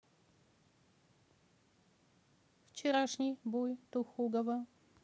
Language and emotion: Russian, neutral